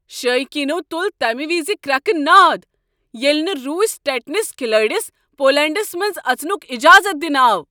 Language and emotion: Kashmiri, angry